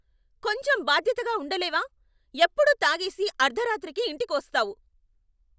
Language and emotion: Telugu, angry